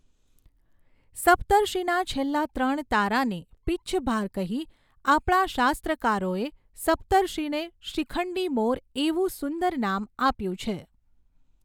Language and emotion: Gujarati, neutral